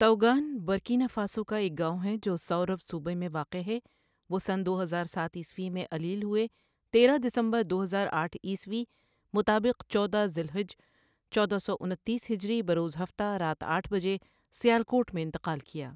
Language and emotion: Urdu, neutral